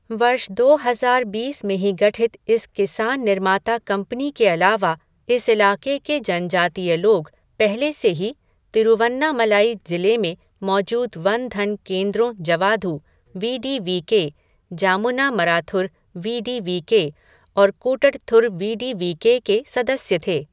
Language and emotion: Hindi, neutral